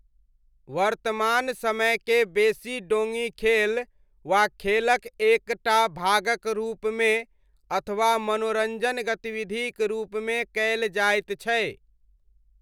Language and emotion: Maithili, neutral